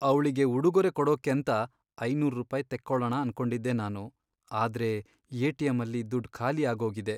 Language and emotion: Kannada, sad